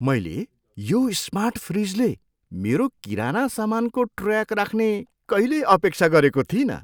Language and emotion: Nepali, surprised